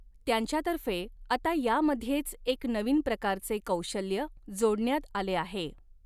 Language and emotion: Marathi, neutral